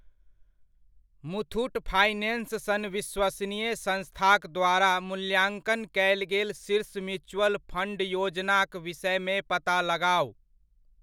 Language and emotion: Maithili, neutral